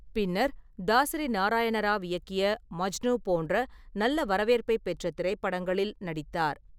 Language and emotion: Tamil, neutral